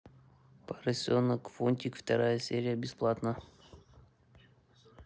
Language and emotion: Russian, neutral